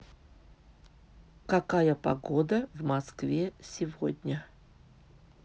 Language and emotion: Russian, neutral